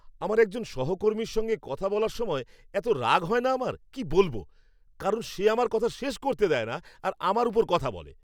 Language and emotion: Bengali, angry